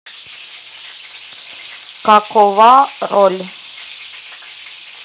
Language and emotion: Russian, neutral